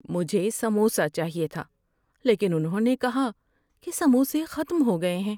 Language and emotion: Urdu, sad